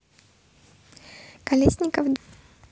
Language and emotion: Russian, neutral